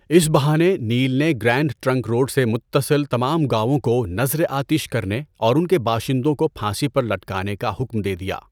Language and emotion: Urdu, neutral